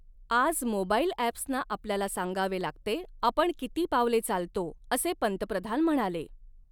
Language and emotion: Marathi, neutral